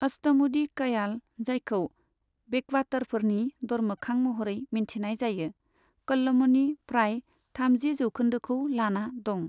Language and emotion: Bodo, neutral